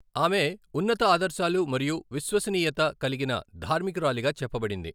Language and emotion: Telugu, neutral